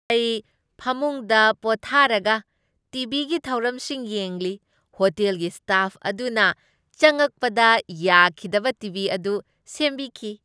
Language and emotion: Manipuri, happy